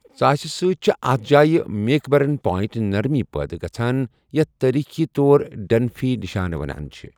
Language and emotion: Kashmiri, neutral